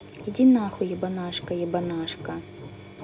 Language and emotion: Russian, angry